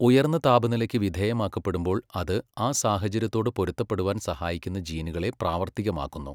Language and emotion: Malayalam, neutral